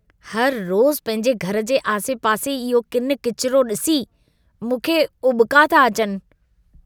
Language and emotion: Sindhi, disgusted